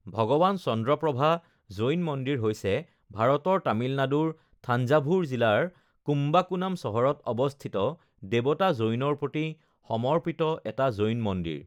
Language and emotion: Assamese, neutral